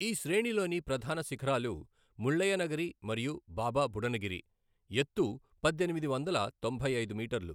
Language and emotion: Telugu, neutral